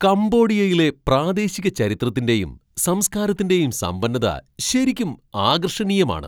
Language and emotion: Malayalam, surprised